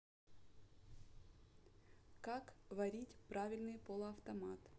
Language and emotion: Russian, neutral